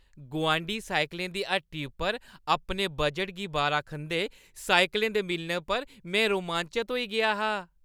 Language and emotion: Dogri, happy